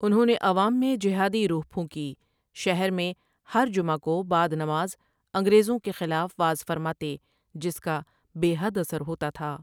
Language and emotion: Urdu, neutral